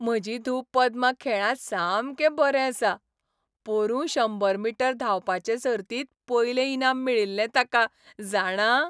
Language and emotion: Goan Konkani, happy